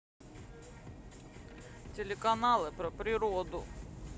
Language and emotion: Russian, sad